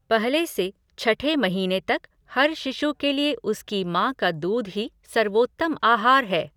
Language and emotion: Hindi, neutral